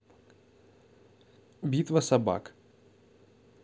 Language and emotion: Russian, neutral